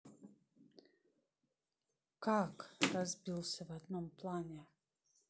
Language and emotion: Russian, neutral